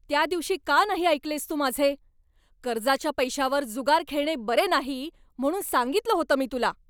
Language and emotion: Marathi, angry